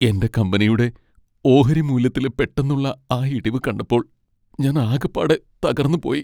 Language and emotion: Malayalam, sad